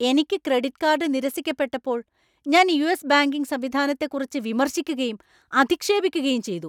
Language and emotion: Malayalam, angry